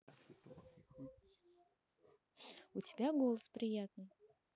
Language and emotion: Russian, neutral